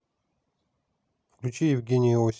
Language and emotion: Russian, neutral